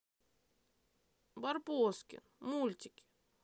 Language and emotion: Russian, sad